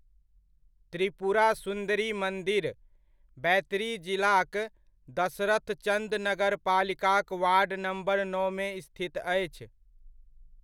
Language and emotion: Maithili, neutral